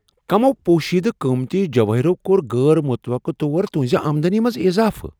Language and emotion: Kashmiri, surprised